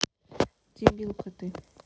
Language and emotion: Russian, neutral